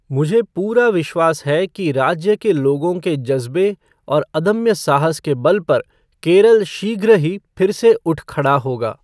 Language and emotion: Hindi, neutral